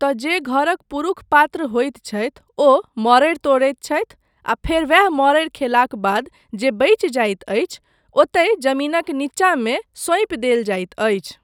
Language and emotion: Maithili, neutral